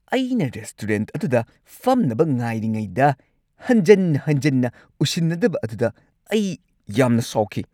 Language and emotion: Manipuri, angry